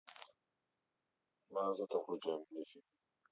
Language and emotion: Russian, neutral